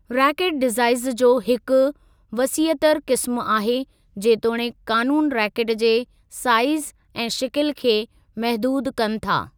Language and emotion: Sindhi, neutral